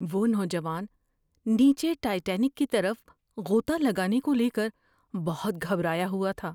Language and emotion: Urdu, fearful